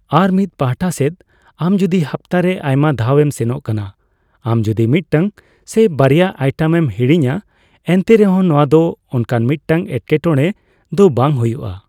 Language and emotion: Santali, neutral